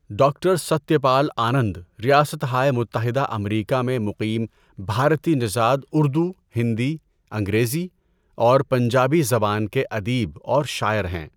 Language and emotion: Urdu, neutral